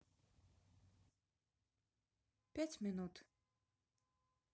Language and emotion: Russian, neutral